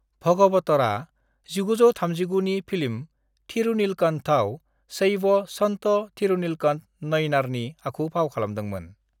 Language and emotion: Bodo, neutral